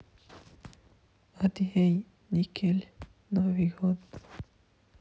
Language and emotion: Russian, sad